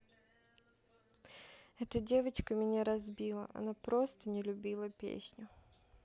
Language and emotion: Russian, sad